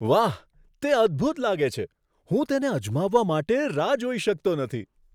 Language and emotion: Gujarati, surprised